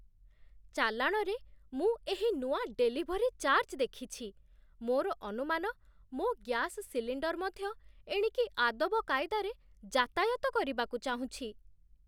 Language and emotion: Odia, surprised